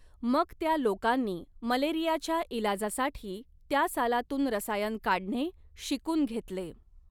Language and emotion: Marathi, neutral